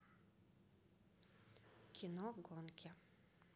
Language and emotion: Russian, neutral